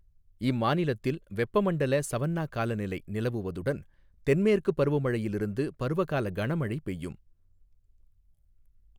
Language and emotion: Tamil, neutral